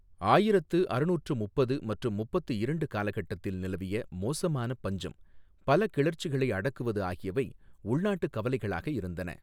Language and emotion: Tamil, neutral